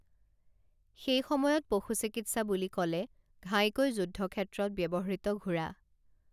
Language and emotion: Assamese, neutral